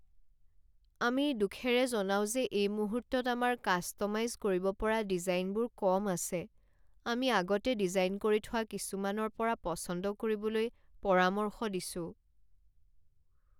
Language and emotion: Assamese, sad